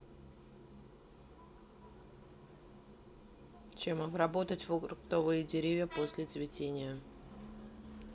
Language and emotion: Russian, neutral